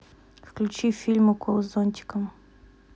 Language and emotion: Russian, neutral